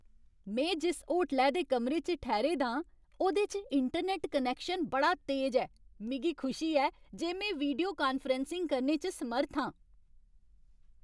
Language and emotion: Dogri, happy